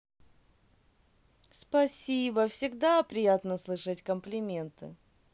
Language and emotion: Russian, positive